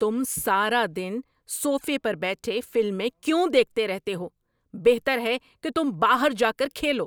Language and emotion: Urdu, angry